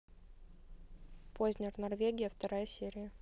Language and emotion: Russian, neutral